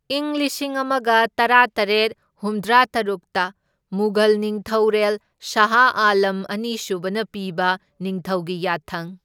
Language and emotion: Manipuri, neutral